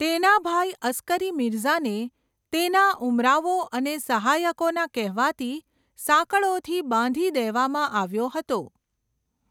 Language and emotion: Gujarati, neutral